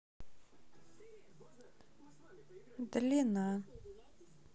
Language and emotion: Russian, sad